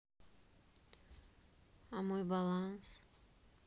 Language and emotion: Russian, neutral